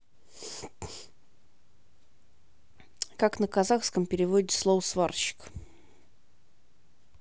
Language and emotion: Russian, neutral